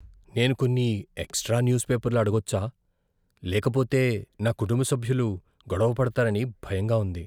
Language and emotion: Telugu, fearful